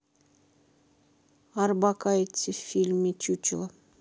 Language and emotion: Russian, neutral